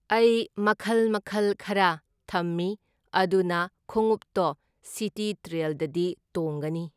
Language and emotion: Manipuri, neutral